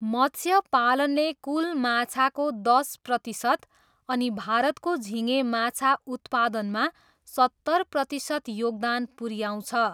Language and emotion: Nepali, neutral